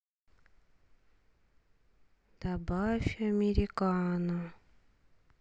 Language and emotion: Russian, sad